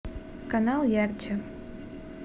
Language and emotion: Russian, neutral